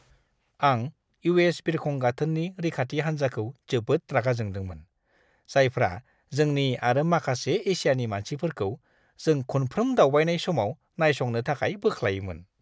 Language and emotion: Bodo, disgusted